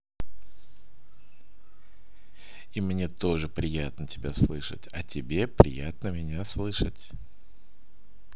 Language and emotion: Russian, positive